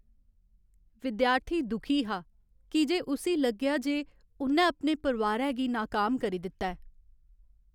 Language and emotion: Dogri, sad